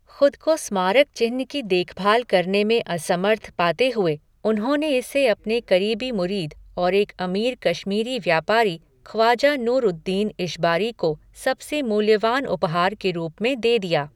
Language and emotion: Hindi, neutral